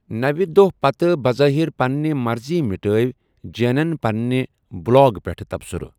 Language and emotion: Kashmiri, neutral